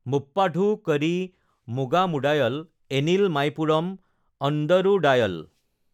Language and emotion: Assamese, neutral